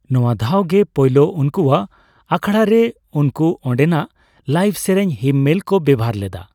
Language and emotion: Santali, neutral